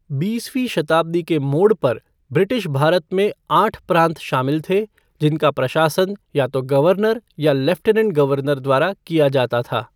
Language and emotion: Hindi, neutral